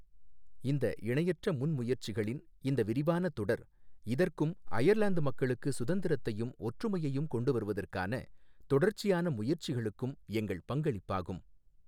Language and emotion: Tamil, neutral